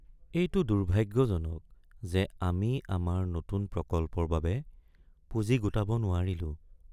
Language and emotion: Assamese, sad